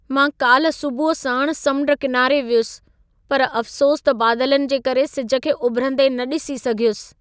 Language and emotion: Sindhi, sad